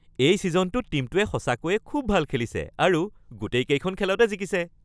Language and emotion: Assamese, happy